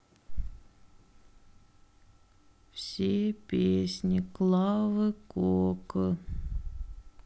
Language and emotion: Russian, sad